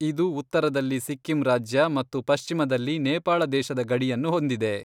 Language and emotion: Kannada, neutral